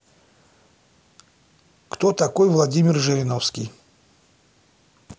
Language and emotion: Russian, neutral